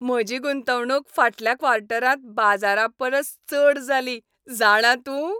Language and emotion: Goan Konkani, happy